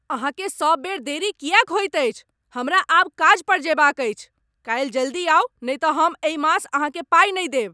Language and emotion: Maithili, angry